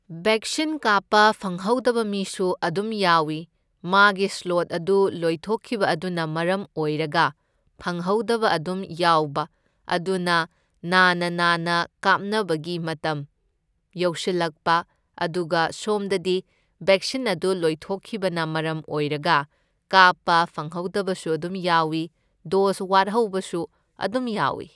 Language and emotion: Manipuri, neutral